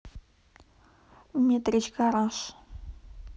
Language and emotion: Russian, neutral